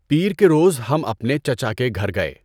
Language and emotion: Urdu, neutral